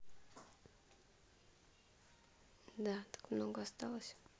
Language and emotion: Russian, neutral